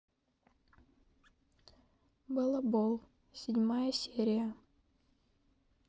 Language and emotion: Russian, neutral